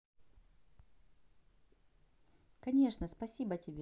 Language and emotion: Russian, positive